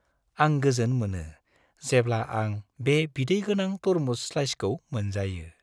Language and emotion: Bodo, happy